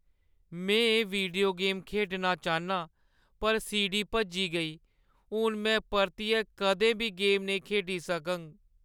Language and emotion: Dogri, sad